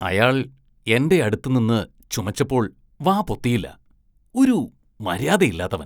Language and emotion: Malayalam, disgusted